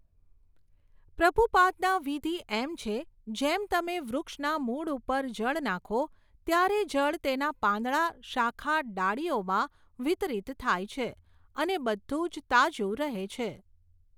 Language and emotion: Gujarati, neutral